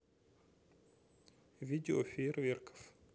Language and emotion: Russian, neutral